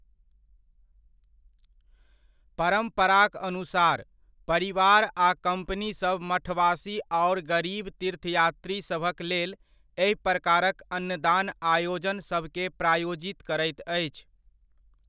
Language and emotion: Maithili, neutral